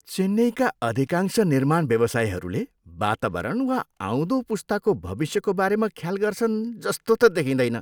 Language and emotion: Nepali, disgusted